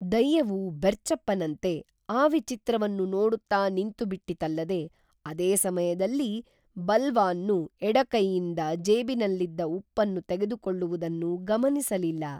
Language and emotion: Kannada, neutral